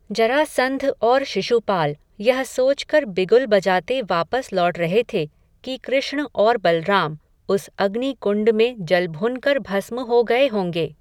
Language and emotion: Hindi, neutral